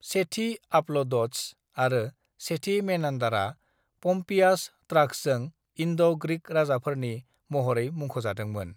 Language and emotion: Bodo, neutral